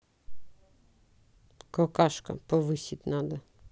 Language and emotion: Russian, neutral